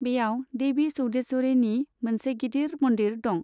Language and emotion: Bodo, neutral